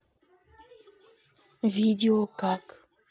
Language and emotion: Russian, neutral